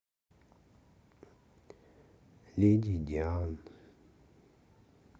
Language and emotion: Russian, sad